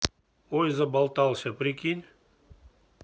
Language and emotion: Russian, neutral